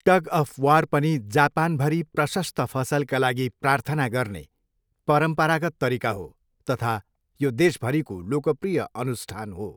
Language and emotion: Nepali, neutral